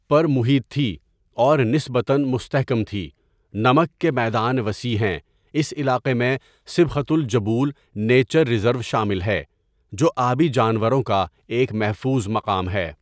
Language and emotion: Urdu, neutral